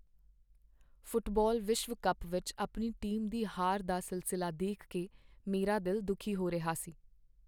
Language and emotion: Punjabi, sad